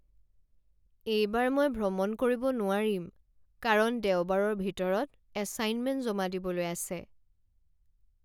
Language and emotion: Assamese, sad